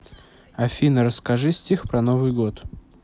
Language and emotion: Russian, neutral